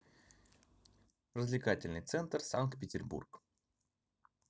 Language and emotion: Russian, neutral